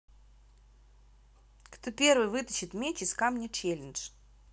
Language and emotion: Russian, neutral